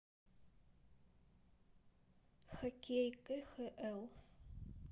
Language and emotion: Russian, neutral